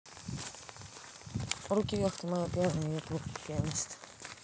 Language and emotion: Russian, neutral